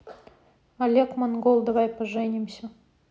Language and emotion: Russian, neutral